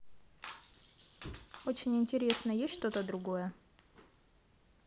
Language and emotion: Russian, neutral